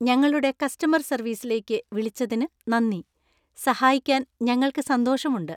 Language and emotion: Malayalam, happy